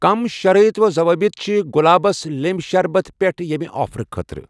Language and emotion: Kashmiri, neutral